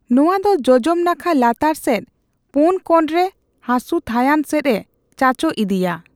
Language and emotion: Santali, neutral